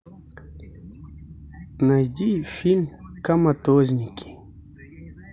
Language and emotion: Russian, neutral